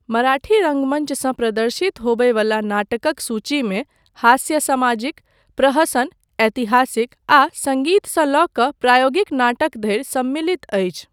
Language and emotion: Maithili, neutral